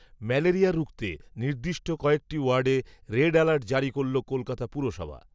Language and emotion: Bengali, neutral